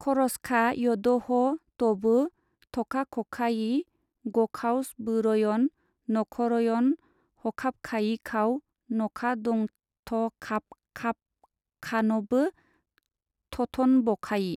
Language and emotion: Bodo, neutral